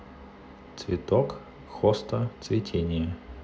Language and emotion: Russian, neutral